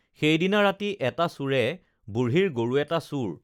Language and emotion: Assamese, neutral